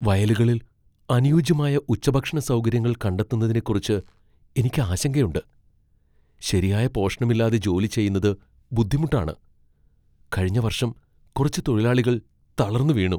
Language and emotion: Malayalam, fearful